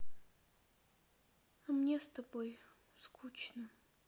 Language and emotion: Russian, sad